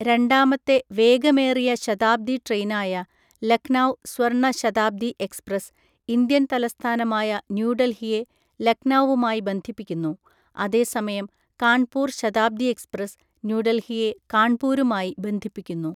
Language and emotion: Malayalam, neutral